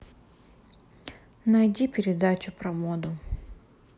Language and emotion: Russian, neutral